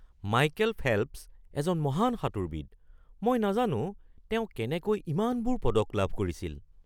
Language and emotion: Assamese, surprised